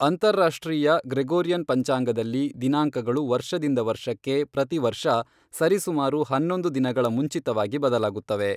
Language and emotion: Kannada, neutral